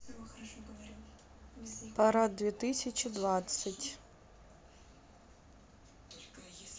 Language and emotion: Russian, neutral